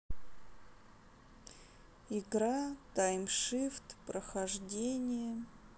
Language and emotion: Russian, sad